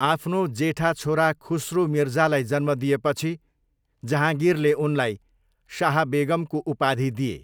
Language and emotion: Nepali, neutral